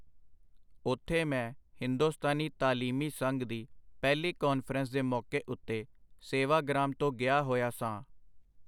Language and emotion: Punjabi, neutral